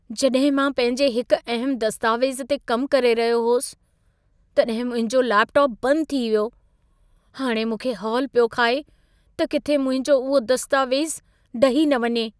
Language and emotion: Sindhi, fearful